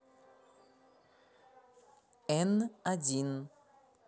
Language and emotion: Russian, neutral